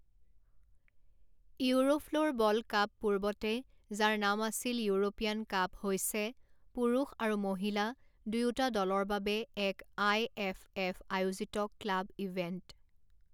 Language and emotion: Assamese, neutral